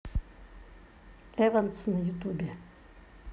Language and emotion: Russian, neutral